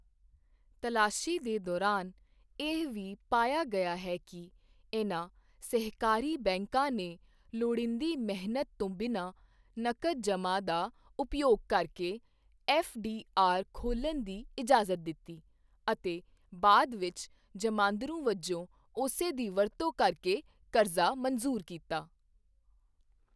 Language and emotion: Punjabi, neutral